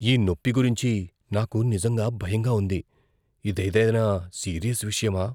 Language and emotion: Telugu, fearful